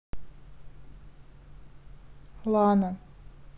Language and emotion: Russian, sad